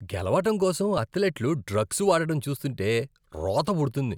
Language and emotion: Telugu, disgusted